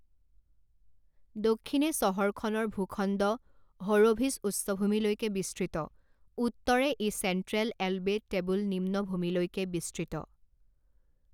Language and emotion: Assamese, neutral